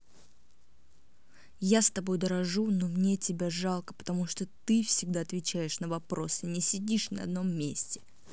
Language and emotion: Russian, angry